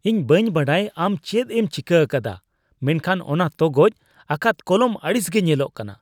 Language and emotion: Santali, disgusted